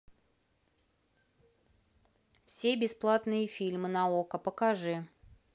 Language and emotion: Russian, neutral